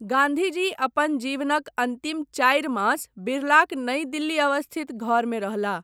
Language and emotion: Maithili, neutral